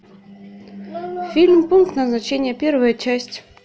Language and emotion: Russian, neutral